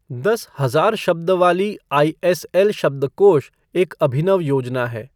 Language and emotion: Hindi, neutral